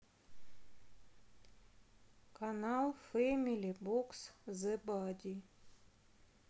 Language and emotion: Russian, neutral